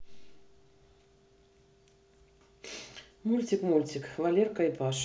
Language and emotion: Russian, neutral